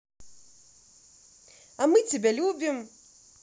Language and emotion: Russian, positive